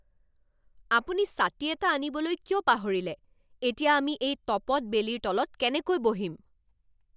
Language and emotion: Assamese, angry